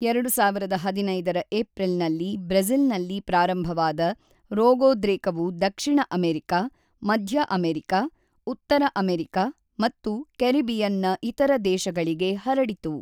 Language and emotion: Kannada, neutral